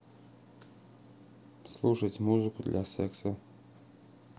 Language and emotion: Russian, neutral